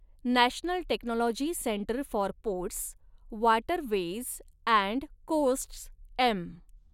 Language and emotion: Marathi, neutral